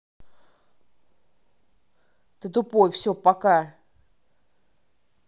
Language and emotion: Russian, angry